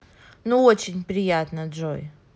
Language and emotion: Russian, positive